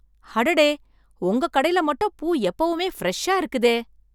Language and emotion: Tamil, surprised